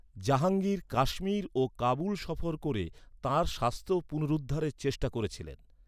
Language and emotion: Bengali, neutral